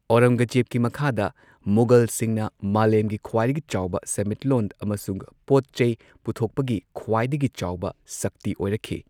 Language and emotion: Manipuri, neutral